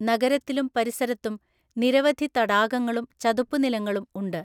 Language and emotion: Malayalam, neutral